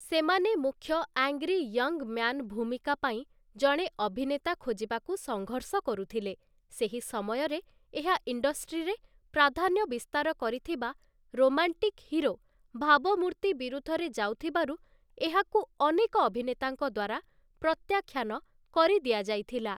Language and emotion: Odia, neutral